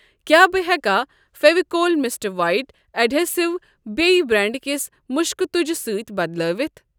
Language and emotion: Kashmiri, neutral